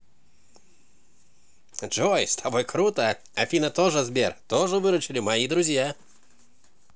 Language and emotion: Russian, positive